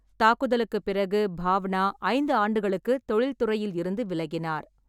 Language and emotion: Tamil, neutral